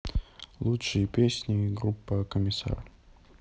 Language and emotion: Russian, neutral